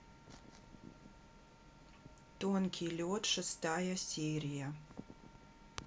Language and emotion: Russian, neutral